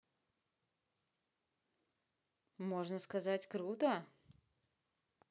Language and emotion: Russian, positive